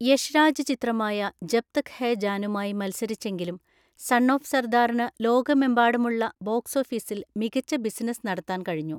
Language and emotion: Malayalam, neutral